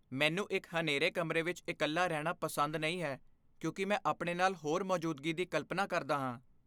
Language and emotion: Punjabi, fearful